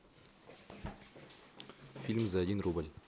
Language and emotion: Russian, neutral